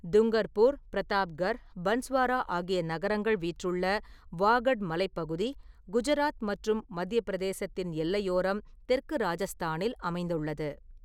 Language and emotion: Tamil, neutral